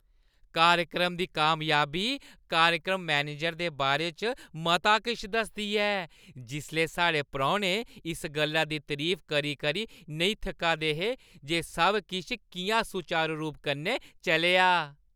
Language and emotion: Dogri, happy